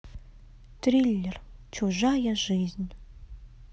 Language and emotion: Russian, sad